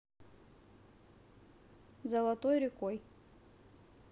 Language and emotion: Russian, neutral